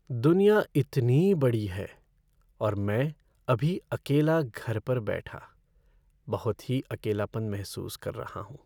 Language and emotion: Hindi, sad